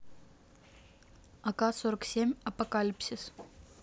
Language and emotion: Russian, neutral